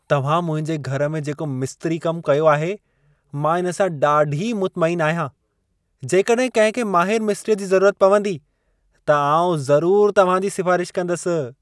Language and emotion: Sindhi, happy